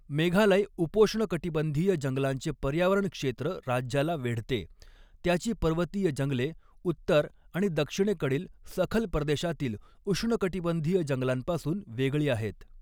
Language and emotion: Marathi, neutral